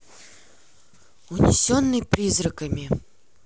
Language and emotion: Russian, neutral